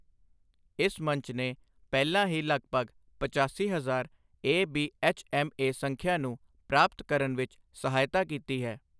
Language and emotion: Punjabi, neutral